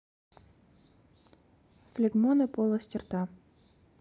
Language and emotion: Russian, neutral